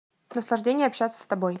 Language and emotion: Russian, neutral